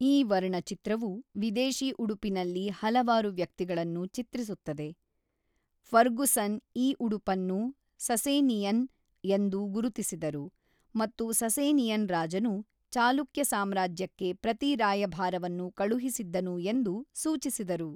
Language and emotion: Kannada, neutral